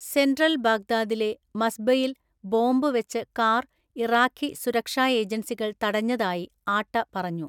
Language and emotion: Malayalam, neutral